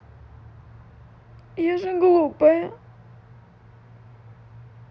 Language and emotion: Russian, sad